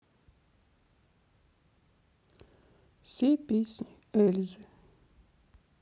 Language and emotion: Russian, sad